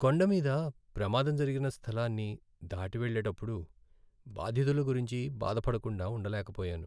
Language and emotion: Telugu, sad